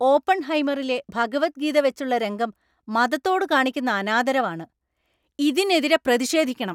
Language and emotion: Malayalam, angry